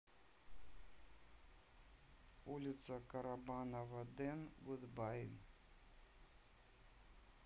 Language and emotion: Russian, neutral